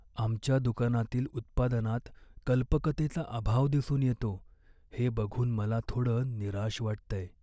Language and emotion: Marathi, sad